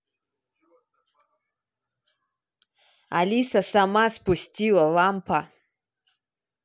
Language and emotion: Russian, angry